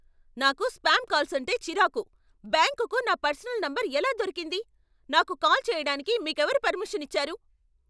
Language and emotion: Telugu, angry